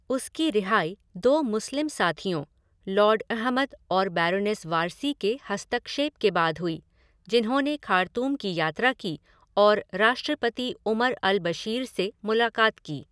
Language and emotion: Hindi, neutral